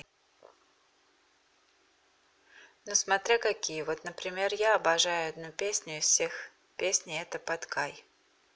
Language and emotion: Russian, neutral